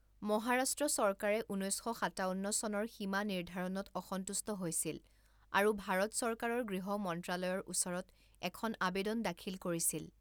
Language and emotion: Assamese, neutral